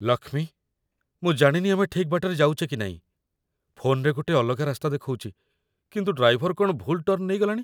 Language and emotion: Odia, fearful